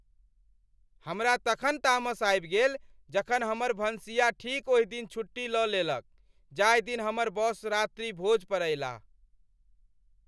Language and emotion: Maithili, angry